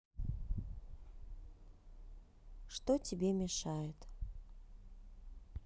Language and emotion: Russian, neutral